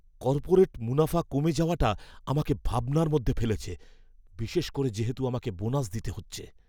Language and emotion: Bengali, fearful